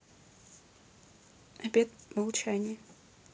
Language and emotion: Russian, neutral